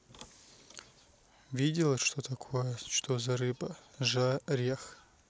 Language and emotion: Russian, neutral